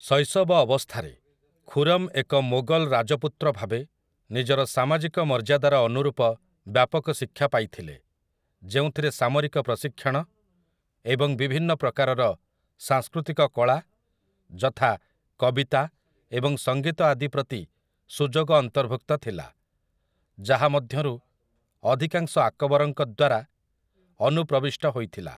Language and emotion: Odia, neutral